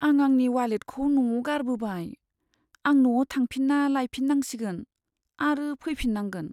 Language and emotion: Bodo, sad